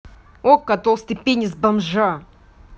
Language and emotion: Russian, angry